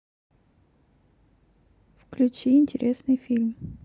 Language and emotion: Russian, neutral